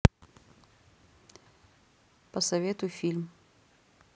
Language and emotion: Russian, neutral